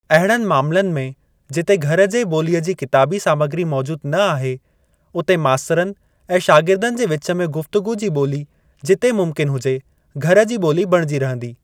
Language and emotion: Sindhi, neutral